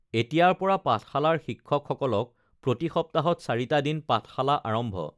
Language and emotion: Assamese, neutral